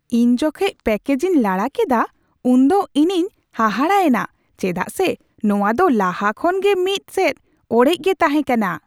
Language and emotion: Santali, surprised